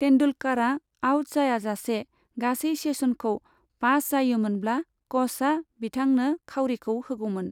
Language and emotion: Bodo, neutral